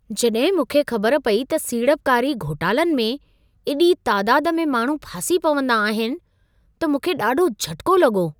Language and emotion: Sindhi, surprised